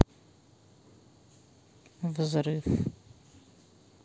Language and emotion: Russian, sad